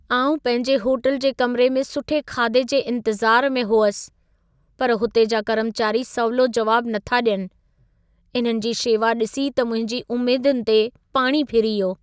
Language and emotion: Sindhi, sad